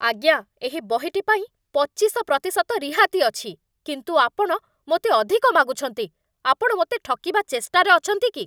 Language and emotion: Odia, angry